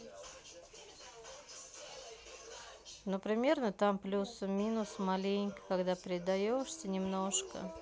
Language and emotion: Russian, neutral